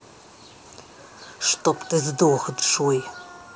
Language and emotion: Russian, angry